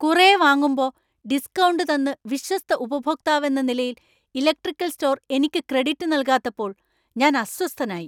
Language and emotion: Malayalam, angry